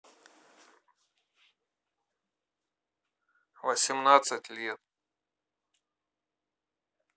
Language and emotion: Russian, neutral